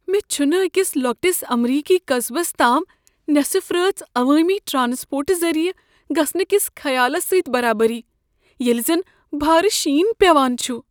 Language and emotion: Kashmiri, fearful